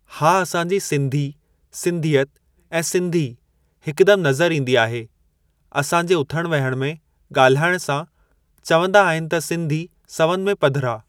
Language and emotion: Sindhi, neutral